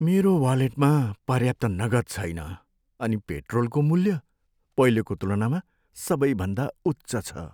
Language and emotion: Nepali, sad